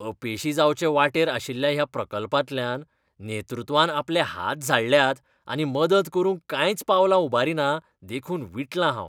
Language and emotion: Goan Konkani, disgusted